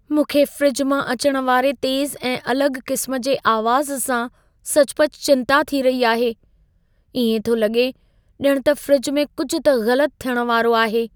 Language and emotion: Sindhi, fearful